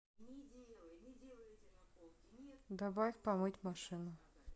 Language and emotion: Russian, neutral